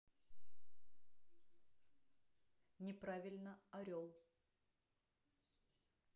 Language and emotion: Russian, neutral